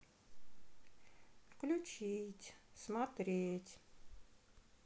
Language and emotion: Russian, sad